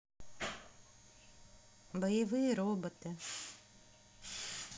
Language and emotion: Russian, neutral